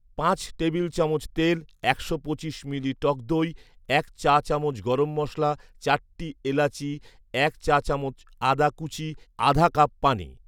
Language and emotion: Bengali, neutral